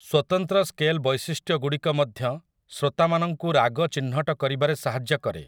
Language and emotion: Odia, neutral